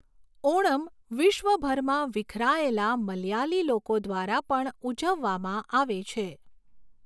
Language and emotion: Gujarati, neutral